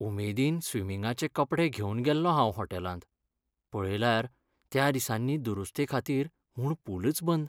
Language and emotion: Goan Konkani, sad